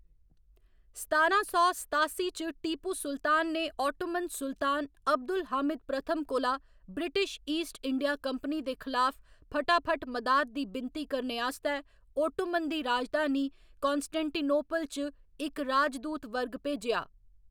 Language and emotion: Dogri, neutral